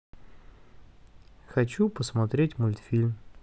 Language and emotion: Russian, neutral